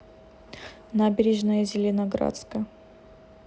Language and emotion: Russian, neutral